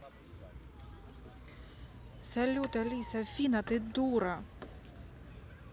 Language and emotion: Russian, angry